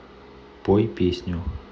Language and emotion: Russian, neutral